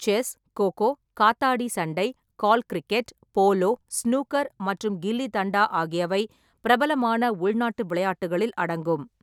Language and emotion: Tamil, neutral